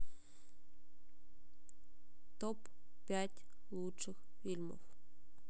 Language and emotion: Russian, neutral